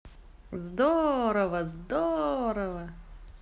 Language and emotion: Russian, positive